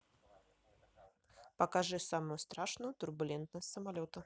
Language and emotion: Russian, neutral